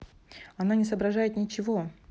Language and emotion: Russian, neutral